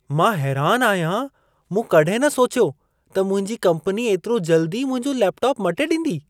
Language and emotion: Sindhi, surprised